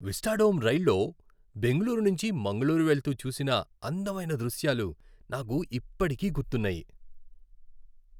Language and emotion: Telugu, happy